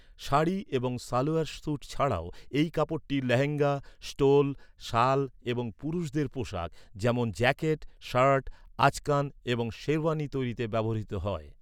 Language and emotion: Bengali, neutral